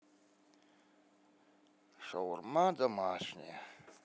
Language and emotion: Russian, sad